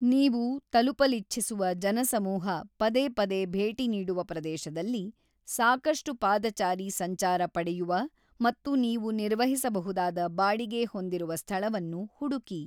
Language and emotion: Kannada, neutral